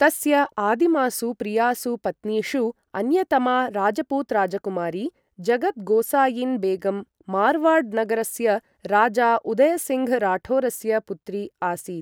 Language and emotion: Sanskrit, neutral